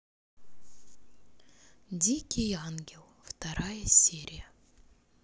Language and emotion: Russian, neutral